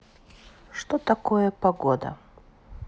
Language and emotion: Russian, neutral